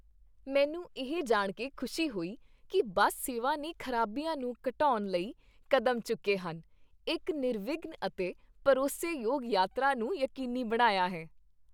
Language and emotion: Punjabi, happy